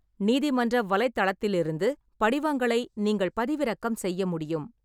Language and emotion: Tamil, neutral